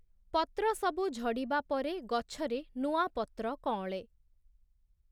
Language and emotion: Odia, neutral